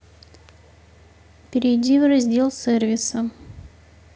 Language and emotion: Russian, neutral